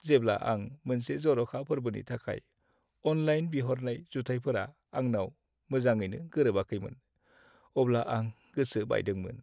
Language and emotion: Bodo, sad